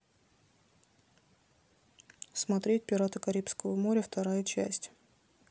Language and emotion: Russian, neutral